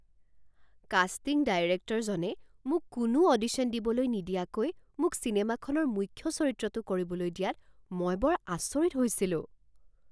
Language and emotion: Assamese, surprised